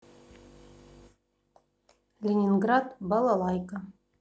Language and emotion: Russian, neutral